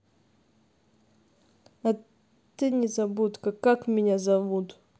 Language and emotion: Russian, neutral